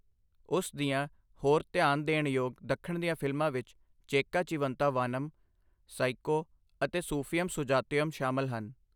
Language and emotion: Punjabi, neutral